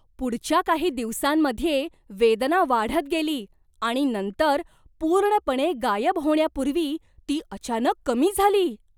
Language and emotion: Marathi, surprised